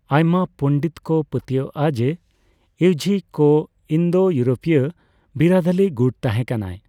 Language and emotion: Santali, neutral